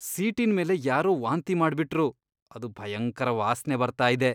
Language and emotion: Kannada, disgusted